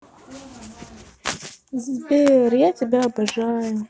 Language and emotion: Russian, sad